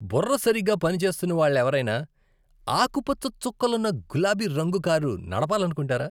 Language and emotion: Telugu, disgusted